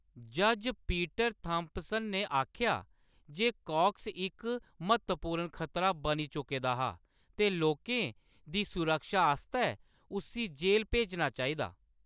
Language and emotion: Dogri, neutral